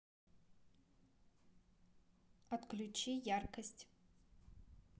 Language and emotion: Russian, neutral